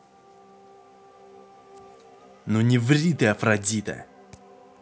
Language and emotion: Russian, angry